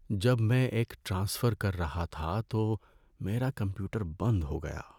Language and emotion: Urdu, sad